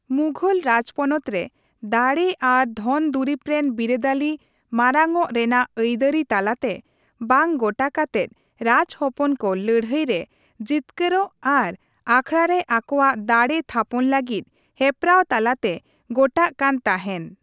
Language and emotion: Santali, neutral